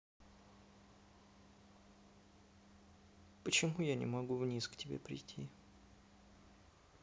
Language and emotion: Russian, sad